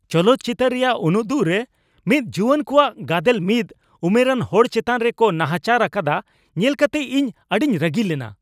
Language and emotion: Santali, angry